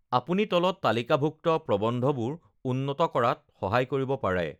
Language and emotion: Assamese, neutral